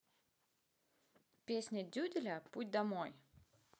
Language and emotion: Russian, neutral